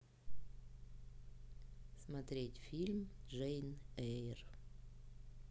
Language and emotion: Russian, neutral